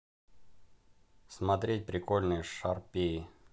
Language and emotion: Russian, neutral